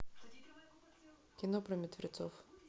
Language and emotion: Russian, neutral